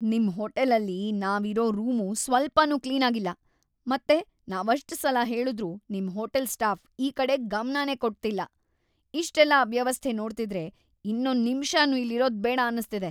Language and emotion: Kannada, disgusted